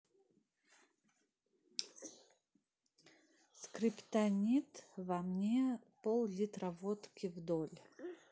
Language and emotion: Russian, neutral